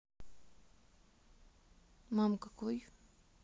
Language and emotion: Russian, neutral